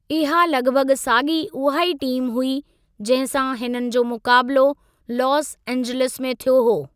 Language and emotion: Sindhi, neutral